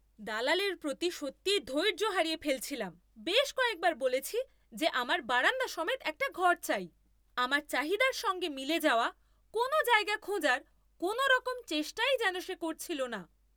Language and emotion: Bengali, angry